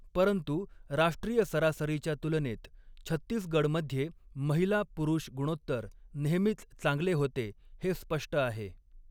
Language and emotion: Marathi, neutral